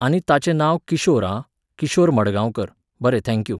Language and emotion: Goan Konkani, neutral